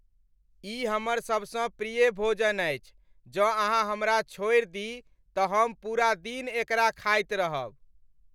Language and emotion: Maithili, happy